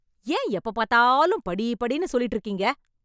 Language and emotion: Tamil, angry